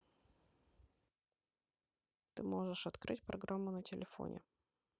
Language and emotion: Russian, neutral